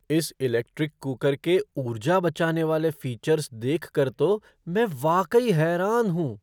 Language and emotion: Hindi, surprised